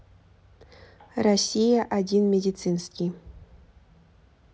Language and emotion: Russian, neutral